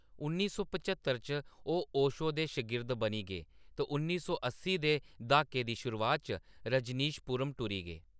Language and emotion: Dogri, neutral